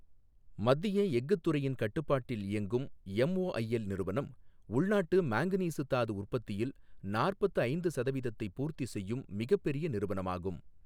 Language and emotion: Tamil, neutral